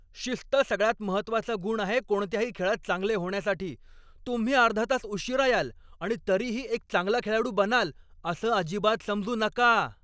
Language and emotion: Marathi, angry